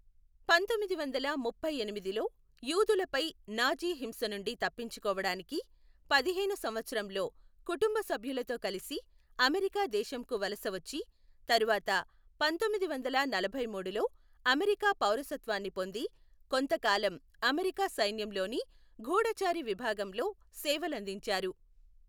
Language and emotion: Telugu, neutral